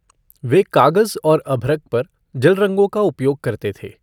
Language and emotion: Hindi, neutral